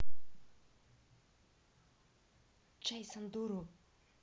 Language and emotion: Russian, neutral